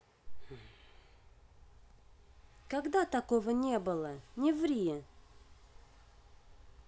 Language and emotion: Russian, neutral